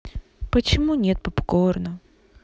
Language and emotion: Russian, sad